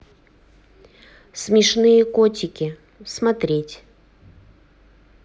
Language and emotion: Russian, neutral